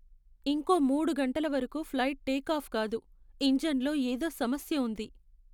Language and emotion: Telugu, sad